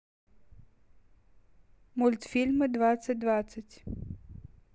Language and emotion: Russian, neutral